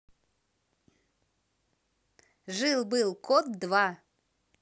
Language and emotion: Russian, positive